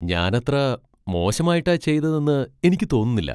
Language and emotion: Malayalam, surprised